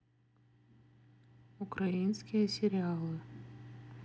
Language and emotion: Russian, neutral